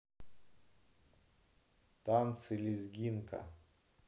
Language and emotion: Russian, neutral